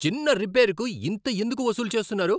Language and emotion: Telugu, angry